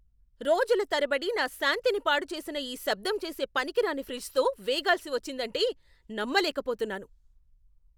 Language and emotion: Telugu, angry